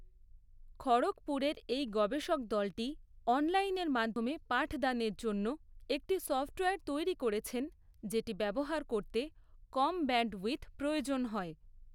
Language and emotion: Bengali, neutral